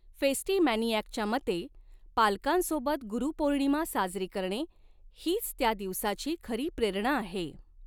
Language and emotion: Marathi, neutral